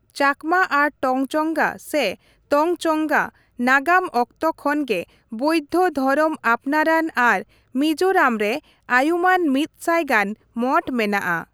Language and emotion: Santali, neutral